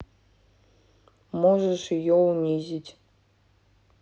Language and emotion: Russian, neutral